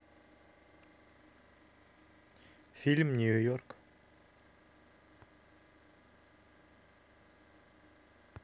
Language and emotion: Russian, neutral